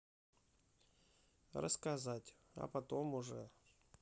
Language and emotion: Russian, neutral